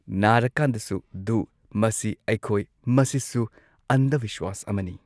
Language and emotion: Manipuri, neutral